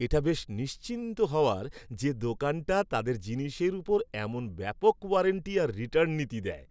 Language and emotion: Bengali, happy